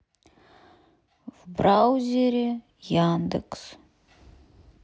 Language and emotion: Russian, sad